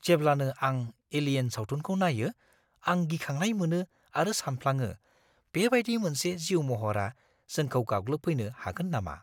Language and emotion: Bodo, fearful